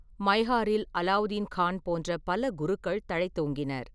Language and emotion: Tamil, neutral